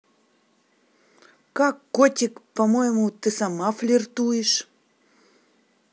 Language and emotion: Russian, neutral